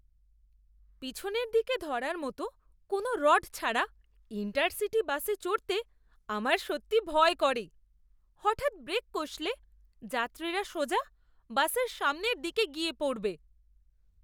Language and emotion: Bengali, disgusted